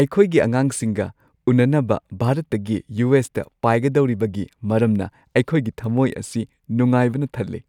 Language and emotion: Manipuri, happy